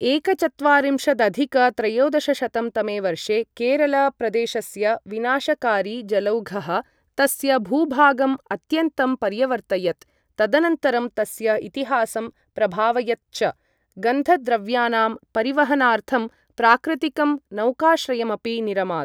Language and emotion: Sanskrit, neutral